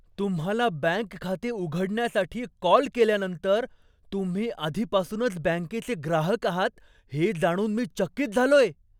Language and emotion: Marathi, surprised